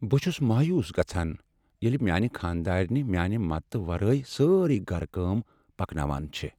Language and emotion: Kashmiri, sad